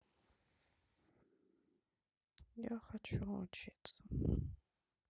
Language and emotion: Russian, sad